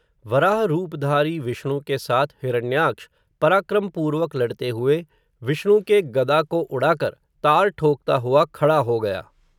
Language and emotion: Hindi, neutral